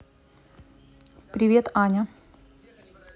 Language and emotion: Russian, neutral